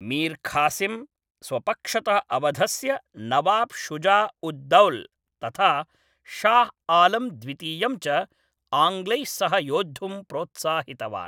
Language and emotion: Sanskrit, neutral